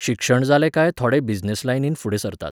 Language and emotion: Goan Konkani, neutral